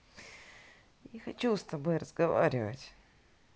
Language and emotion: Russian, sad